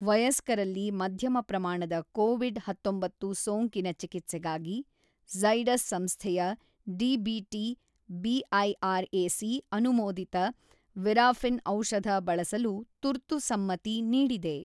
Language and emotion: Kannada, neutral